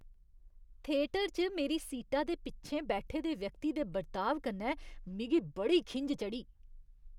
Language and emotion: Dogri, disgusted